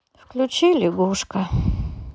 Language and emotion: Russian, sad